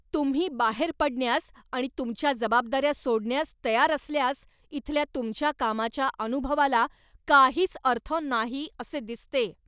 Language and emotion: Marathi, angry